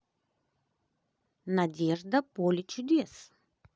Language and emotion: Russian, positive